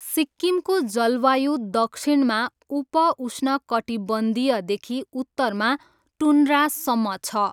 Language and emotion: Nepali, neutral